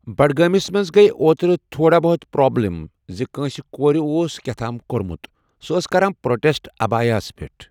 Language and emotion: Kashmiri, neutral